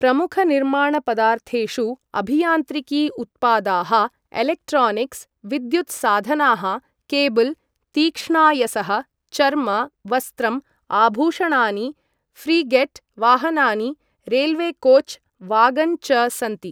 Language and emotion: Sanskrit, neutral